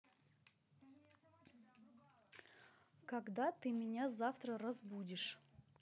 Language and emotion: Russian, angry